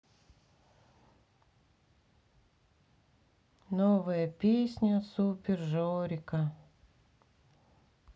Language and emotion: Russian, sad